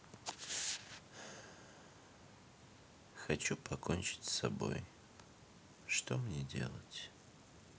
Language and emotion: Russian, sad